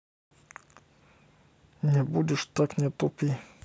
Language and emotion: Russian, angry